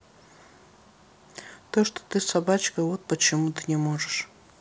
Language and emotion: Russian, sad